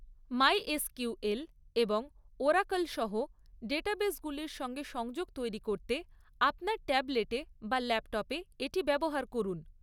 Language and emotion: Bengali, neutral